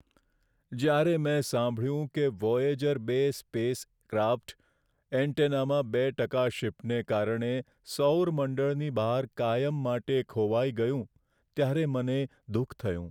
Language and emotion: Gujarati, sad